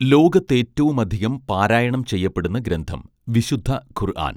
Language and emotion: Malayalam, neutral